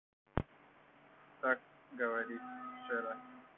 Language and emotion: Russian, neutral